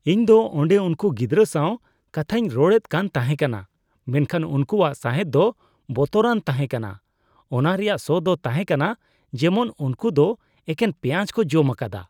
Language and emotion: Santali, disgusted